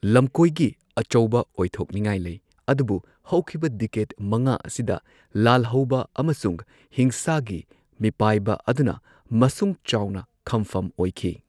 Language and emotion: Manipuri, neutral